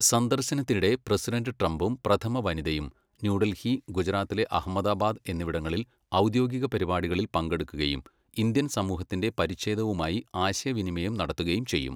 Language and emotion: Malayalam, neutral